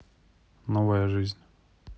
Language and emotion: Russian, neutral